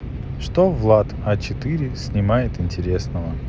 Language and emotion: Russian, neutral